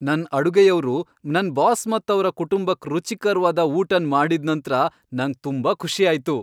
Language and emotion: Kannada, happy